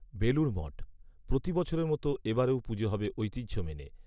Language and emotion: Bengali, neutral